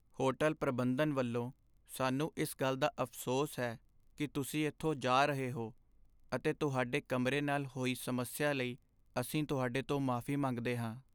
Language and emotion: Punjabi, sad